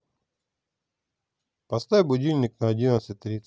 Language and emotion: Russian, neutral